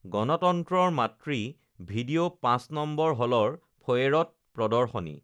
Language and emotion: Assamese, neutral